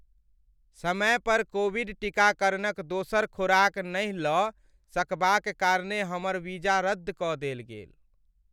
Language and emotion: Maithili, sad